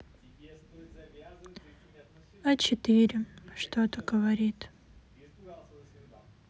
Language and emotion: Russian, sad